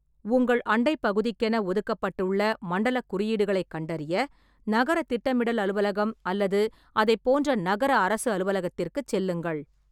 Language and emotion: Tamil, neutral